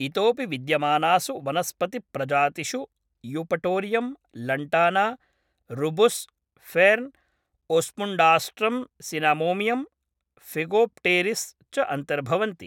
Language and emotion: Sanskrit, neutral